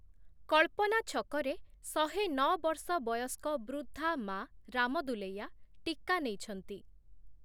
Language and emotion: Odia, neutral